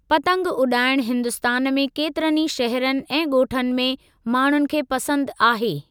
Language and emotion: Sindhi, neutral